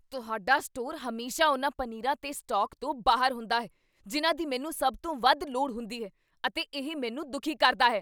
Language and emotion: Punjabi, angry